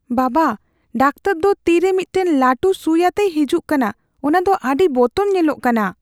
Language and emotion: Santali, fearful